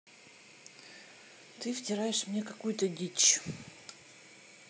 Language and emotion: Russian, neutral